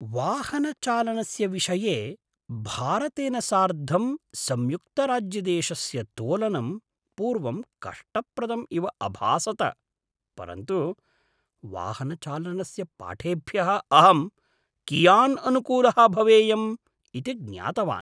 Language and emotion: Sanskrit, surprised